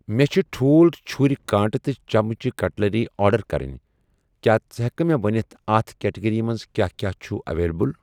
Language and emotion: Kashmiri, neutral